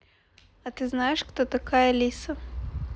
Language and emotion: Russian, neutral